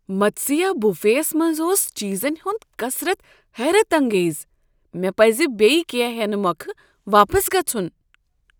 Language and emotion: Kashmiri, surprised